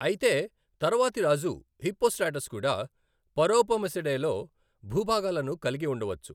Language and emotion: Telugu, neutral